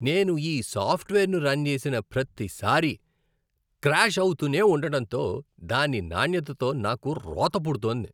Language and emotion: Telugu, disgusted